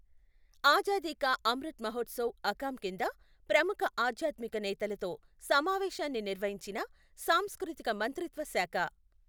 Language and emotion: Telugu, neutral